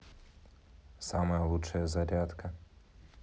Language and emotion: Russian, neutral